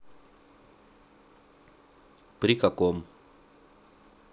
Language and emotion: Russian, neutral